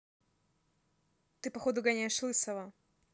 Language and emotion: Russian, neutral